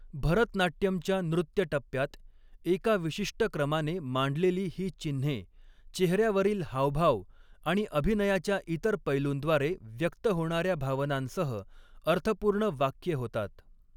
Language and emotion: Marathi, neutral